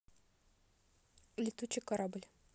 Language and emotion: Russian, neutral